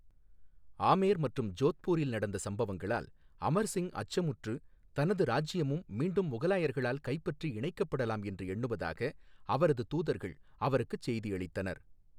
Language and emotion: Tamil, neutral